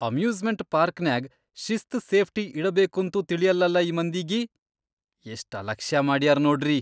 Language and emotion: Kannada, disgusted